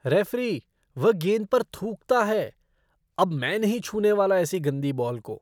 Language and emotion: Hindi, disgusted